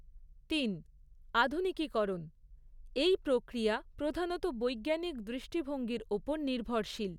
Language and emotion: Bengali, neutral